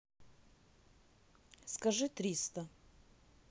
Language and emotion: Russian, neutral